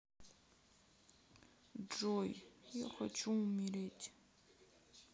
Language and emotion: Russian, sad